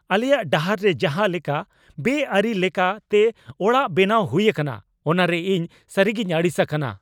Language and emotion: Santali, angry